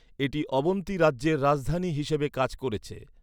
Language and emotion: Bengali, neutral